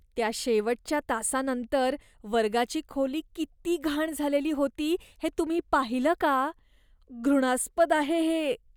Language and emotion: Marathi, disgusted